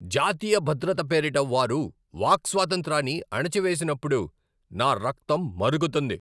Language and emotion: Telugu, angry